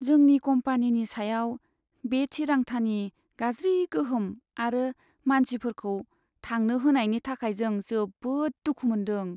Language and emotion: Bodo, sad